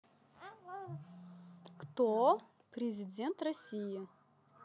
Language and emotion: Russian, positive